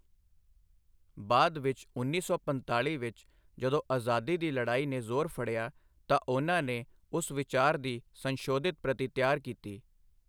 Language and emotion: Punjabi, neutral